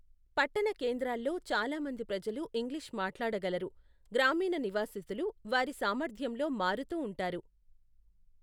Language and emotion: Telugu, neutral